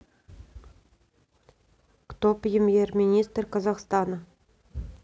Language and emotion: Russian, neutral